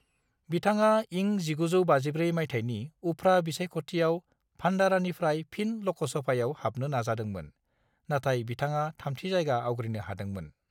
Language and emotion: Bodo, neutral